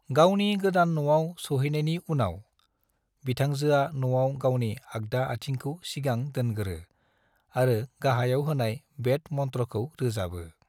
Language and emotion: Bodo, neutral